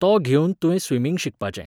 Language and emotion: Goan Konkani, neutral